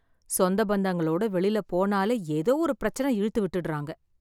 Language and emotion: Tamil, sad